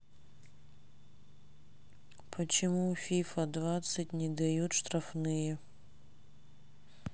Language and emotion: Russian, sad